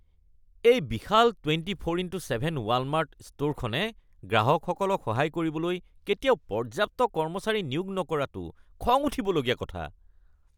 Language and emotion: Assamese, disgusted